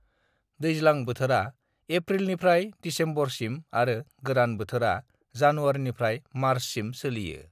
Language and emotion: Bodo, neutral